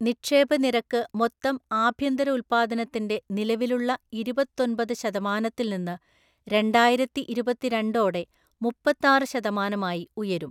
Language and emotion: Malayalam, neutral